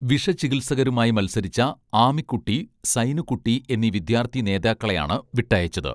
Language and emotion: Malayalam, neutral